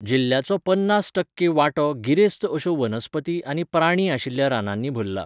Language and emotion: Goan Konkani, neutral